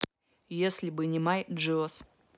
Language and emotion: Russian, neutral